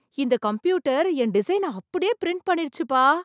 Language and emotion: Tamil, surprised